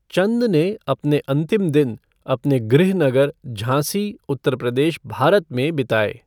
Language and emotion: Hindi, neutral